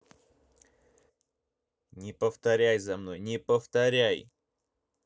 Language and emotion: Russian, angry